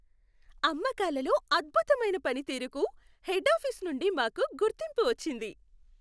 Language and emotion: Telugu, happy